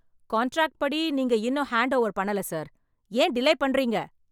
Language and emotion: Tamil, angry